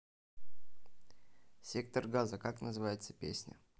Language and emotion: Russian, neutral